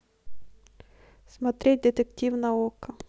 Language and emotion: Russian, neutral